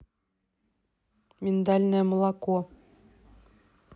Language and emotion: Russian, neutral